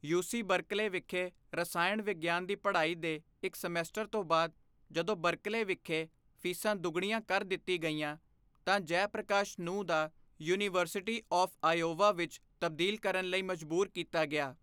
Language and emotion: Punjabi, neutral